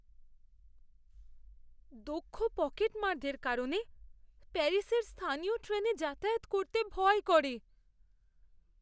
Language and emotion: Bengali, fearful